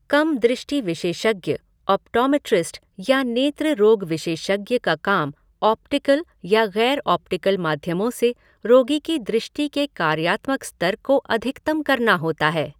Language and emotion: Hindi, neutral